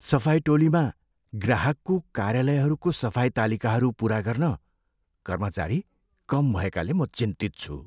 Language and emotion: Nepali, fearful